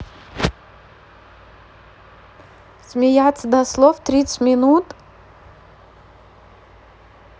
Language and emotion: Russian, neutral